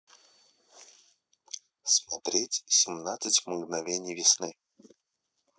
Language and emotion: Russian, neutral